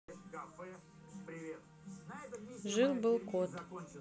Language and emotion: Russian, neutral